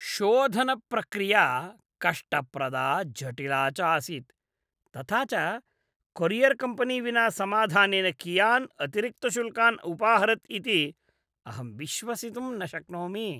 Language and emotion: Sanskrit, disgusted